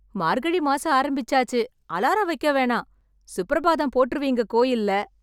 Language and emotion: Tamil, happy